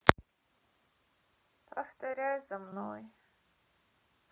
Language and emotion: Russian, sad